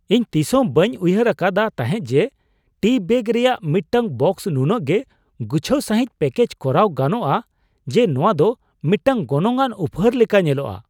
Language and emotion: Santali, surprised